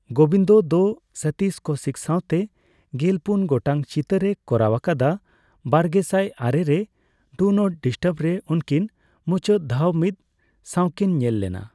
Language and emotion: Santali, neutral